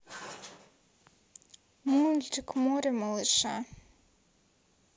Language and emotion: Russian, sad